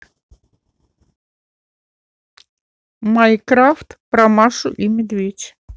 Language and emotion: Russian, neutral